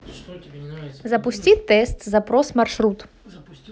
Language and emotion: Russian, neutral